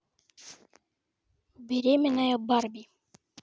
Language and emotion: Russian, neutral